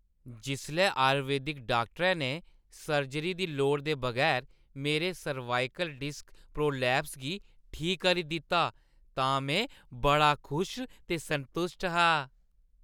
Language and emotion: Dogri, happy